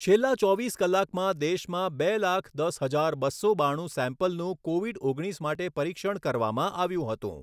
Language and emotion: Gujarati, neutral